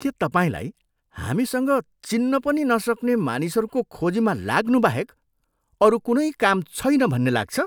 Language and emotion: Nepali, disgusted